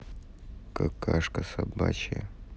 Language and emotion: Russian, neutral